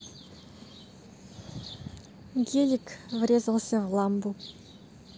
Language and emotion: Russian, neutral